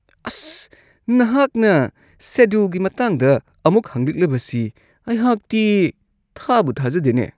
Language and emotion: Manipuri, disgusted